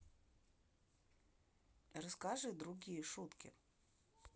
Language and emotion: Russian, neutral